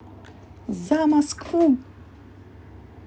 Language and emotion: Russian, positive